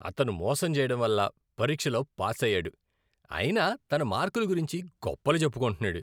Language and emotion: Telugu, disgusted